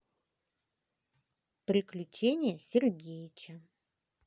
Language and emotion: Russian, positive